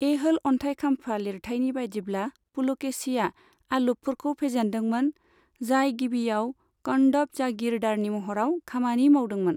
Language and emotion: Bodo, neutral